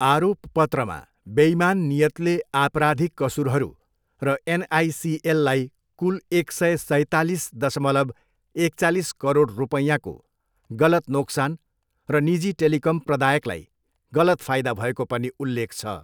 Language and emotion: Nepali, neutral